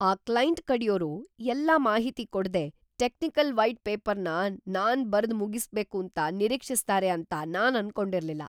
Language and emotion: Kannada, surprised